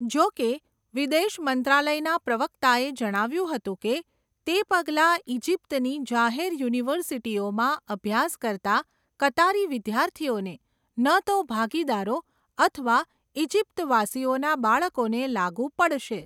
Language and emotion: Gujarati, neutral